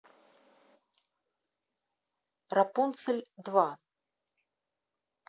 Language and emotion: Russian, neutral